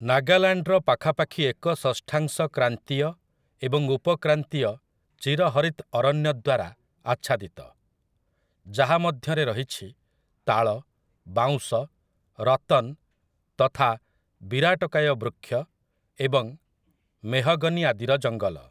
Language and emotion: Odia, neutral